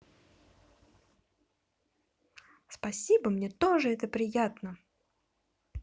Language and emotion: Russian, positive